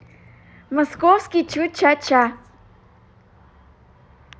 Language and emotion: Russian, positive